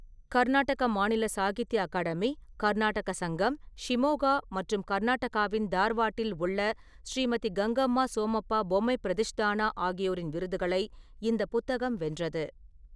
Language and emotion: Tamil, neutral